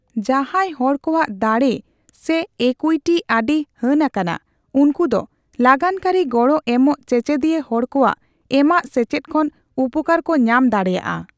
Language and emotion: Santali, neutral